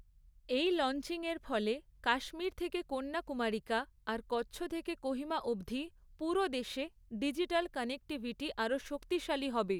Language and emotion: Bengali, neutral